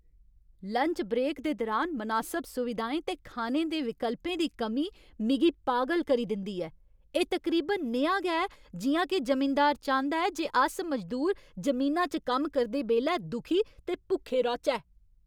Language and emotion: Dogri, angry